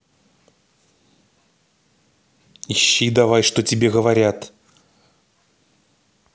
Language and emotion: Russian, angry